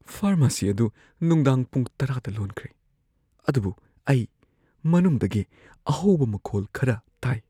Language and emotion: Manipuri, fearful